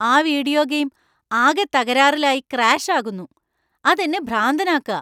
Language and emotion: Malayalam, angry